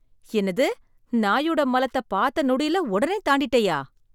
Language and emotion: Tamil, surprised